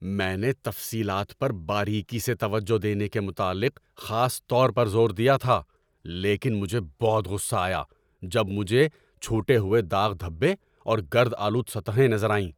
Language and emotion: Urdu, angry